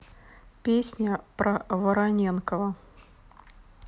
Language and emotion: Russian, neutral